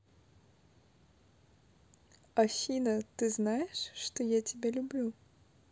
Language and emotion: Russian, positive